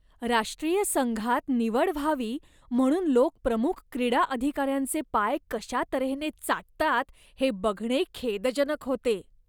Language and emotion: Marathi, disgusted